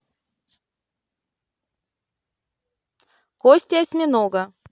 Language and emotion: Russian, neutral